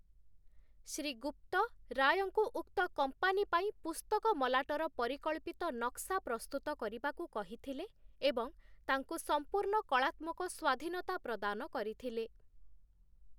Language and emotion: Odia, neutral